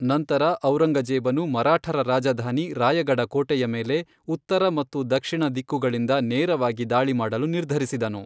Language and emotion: Kannada, neutral